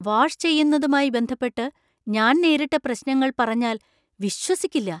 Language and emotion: Malayalam, surprised